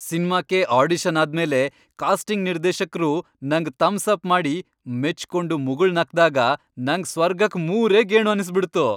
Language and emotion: Kannada, happy